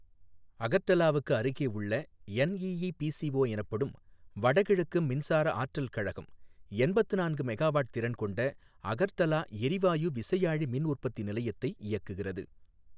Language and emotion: Tamil, neutral